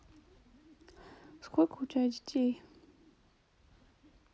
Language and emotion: Russian, neutral